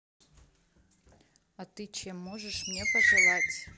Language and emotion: Russian, neutral